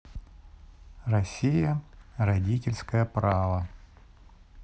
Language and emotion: Russian, neutral